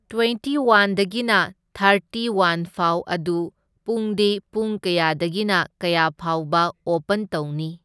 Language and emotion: Manipuri, neutral